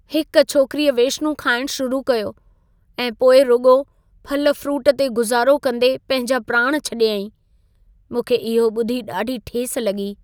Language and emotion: Sindhi, sad